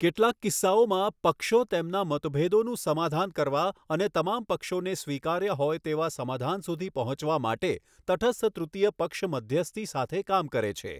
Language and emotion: Gujarati, neutral